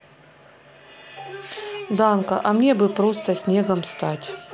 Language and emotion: Russian, neutral